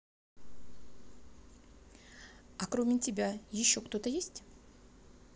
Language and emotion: Russian, neutral